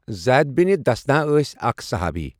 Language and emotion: Kashmiri, neutral